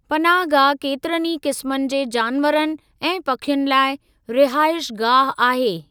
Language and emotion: Sindhi, neutral